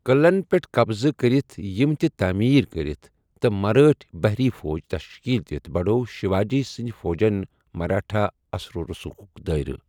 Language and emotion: Kashmiri, neutral